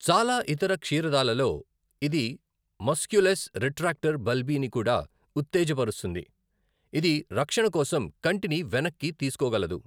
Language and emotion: Telugu, neutral